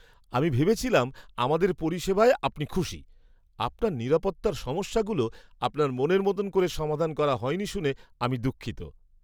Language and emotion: Bengali, surprised